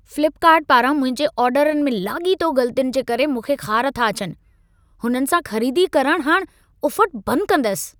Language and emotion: Sindhi, angry